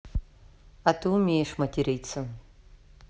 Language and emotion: Russian, neutral